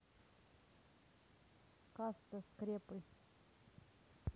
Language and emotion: Russian, neutral